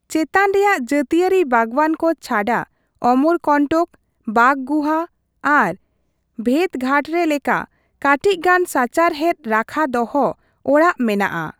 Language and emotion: Santali, neutral